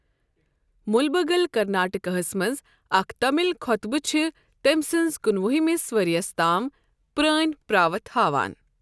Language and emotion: Kashmiri, neutral